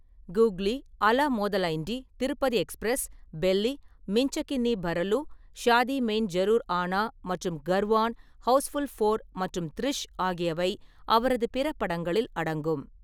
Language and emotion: Tamil, neutral